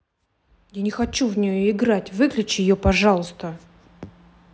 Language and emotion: Russian, angry